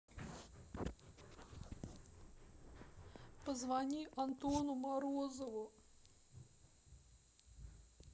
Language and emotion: Russian, sad